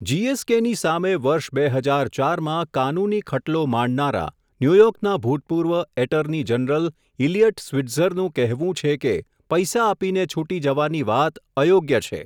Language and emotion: Gujarati, neutral